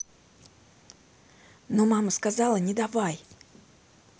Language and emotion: Russian, neutral